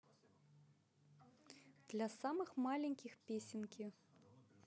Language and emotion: Russian, positive